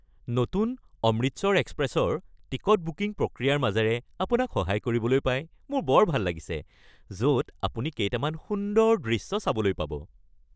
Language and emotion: Assamese, happy